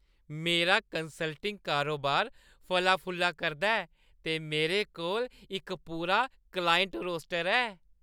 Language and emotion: Dogri, happy